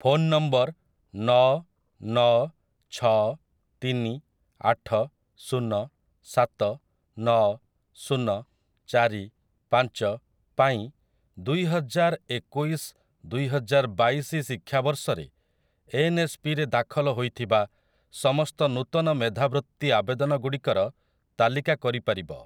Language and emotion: Odia, neutral